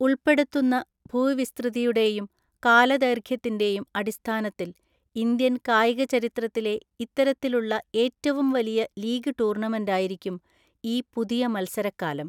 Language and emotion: Malayalam, neutral